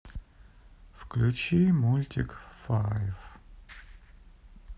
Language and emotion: Russian, sad